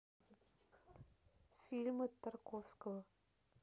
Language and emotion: Russian, neutral